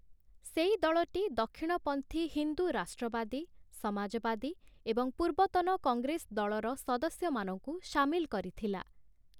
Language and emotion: Odia, neutral